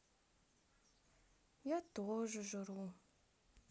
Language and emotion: Russian, sad